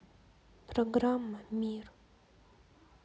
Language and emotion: Russian, sad